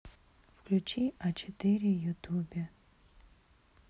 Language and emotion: Russian, neutral